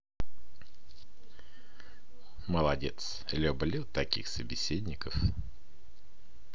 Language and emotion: Russian, positive